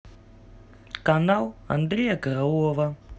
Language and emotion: Russian, neutral